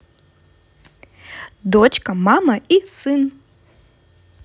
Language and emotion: Russian, positive